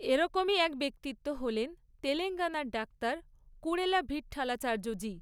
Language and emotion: Bengali, neutral